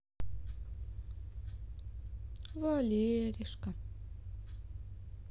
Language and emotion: Russian, sad